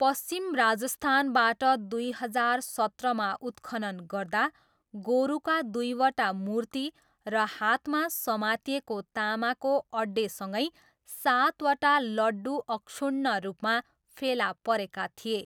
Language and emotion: Nepali, neutral